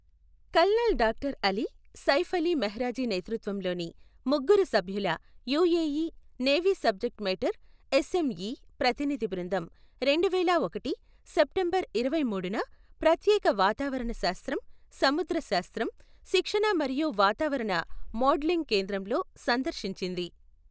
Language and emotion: Telugu, neutral